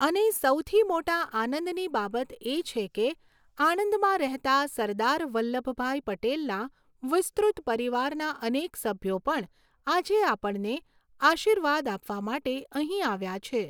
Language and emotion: Gujarati, neutral